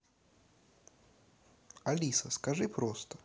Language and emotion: Russian, neutral